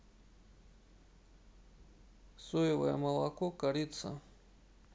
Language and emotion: Russian, neutral